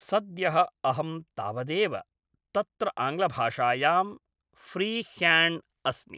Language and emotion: Sanskrit, neutral